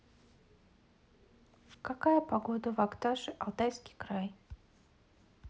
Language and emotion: Russian, neutral